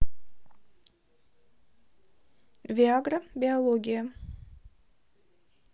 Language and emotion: Russian, neutral